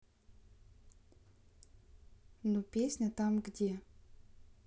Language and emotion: Russian, neutral